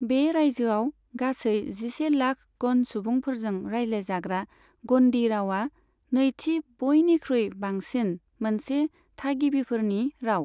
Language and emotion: Bodo, neutral